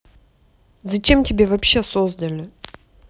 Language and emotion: Russian, angry